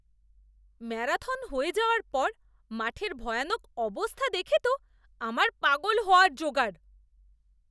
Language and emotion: Bengali, disgusted